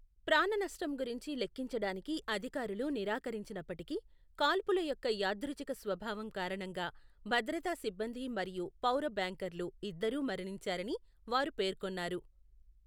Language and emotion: Telugu, neutral